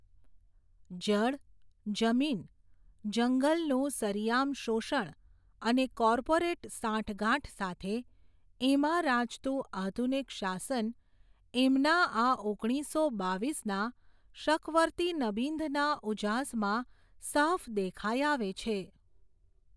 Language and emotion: Gujarati, neutral